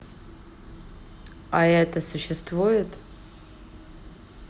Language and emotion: Russian, neutral